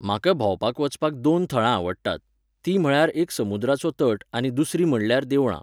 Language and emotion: Goan Konkani, neutral